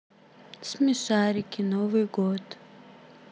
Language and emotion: Russian, sad